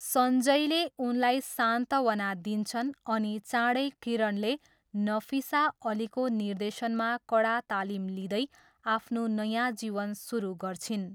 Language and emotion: Nepali, neutral